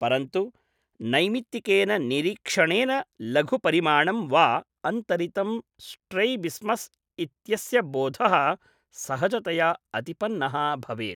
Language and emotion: Sanskrit, neutral